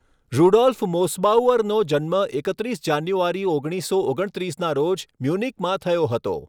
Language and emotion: Gujarati, neutral